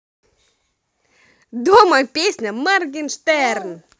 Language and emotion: Russian, positive